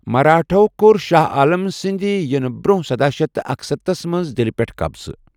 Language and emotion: Kashmiri, neutral